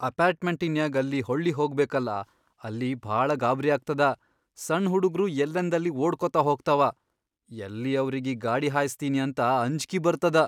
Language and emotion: Kannada, fearful